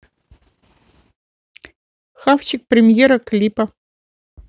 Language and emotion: Russian, neutral